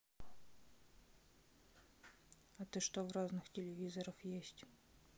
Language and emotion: Russian, sad